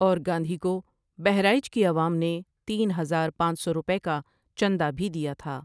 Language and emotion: Urdu, neutral